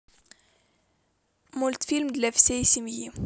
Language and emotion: Russian, positive